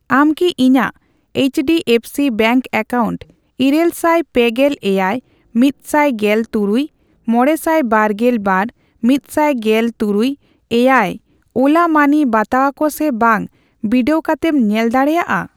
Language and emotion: Santali, neutral